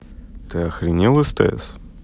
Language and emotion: Russian, neutral